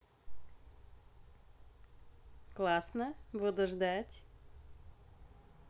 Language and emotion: Russian, positive